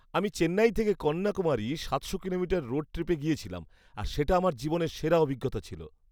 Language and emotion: Bengali, happy